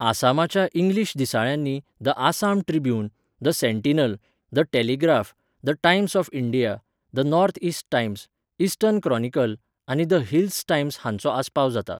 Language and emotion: Goan Konkani, neutral